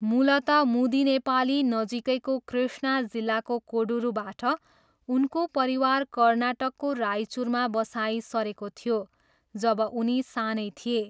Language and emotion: Nepali, neutral